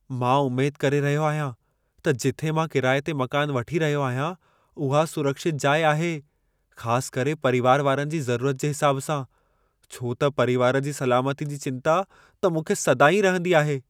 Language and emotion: Sindhi, fearful